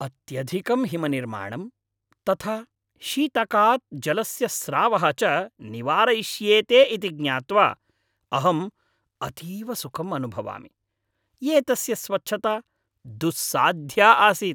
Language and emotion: Sanskrit, happy